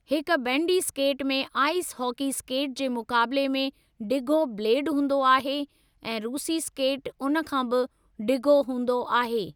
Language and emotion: Sindhi, neutral